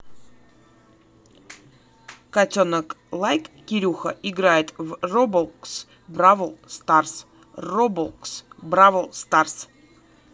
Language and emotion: Russian, neutral